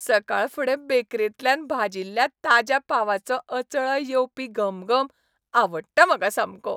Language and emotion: Goan Konkani, happy